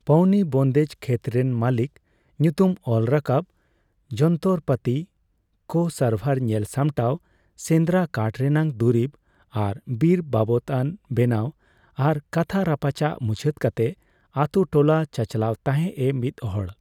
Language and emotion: Santali, neutral